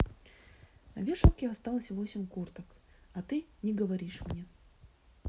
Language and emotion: Russian, neutral